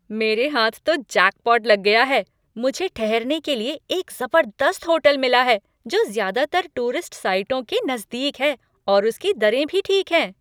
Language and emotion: Hindi, happy